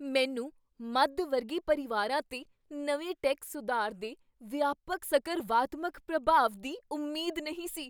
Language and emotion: Punjabi, surprised